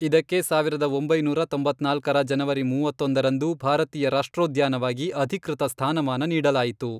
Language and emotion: Kannada, neutral